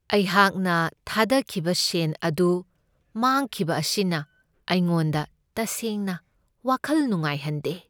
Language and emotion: Manipuri, sad